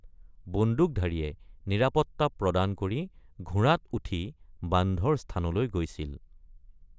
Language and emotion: Assamese, neutral